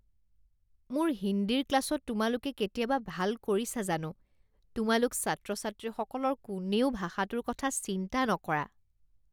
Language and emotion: Assamese, disgusted